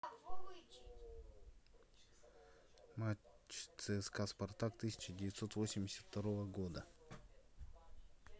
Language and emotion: Russian, neutral